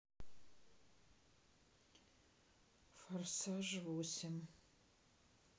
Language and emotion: Russian, sad